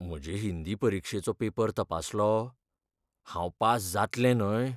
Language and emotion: Goan Konkani, fearful